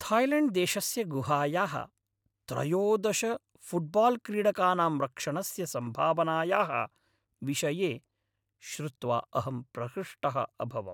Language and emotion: Sanskrit, happy